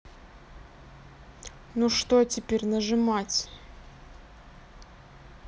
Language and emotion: Russian, neutral